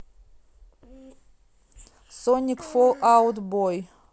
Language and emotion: Russian, neutral